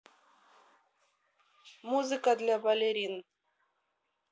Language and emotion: Russian, neutral